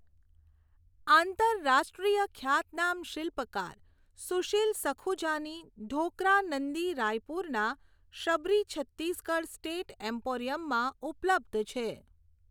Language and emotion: Gujarati, neutral